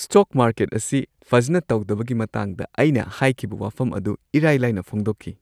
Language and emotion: Manipuri, happy